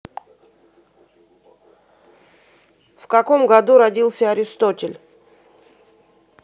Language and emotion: Russian, neutral